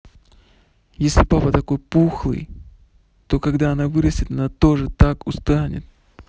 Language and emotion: Russian, neutral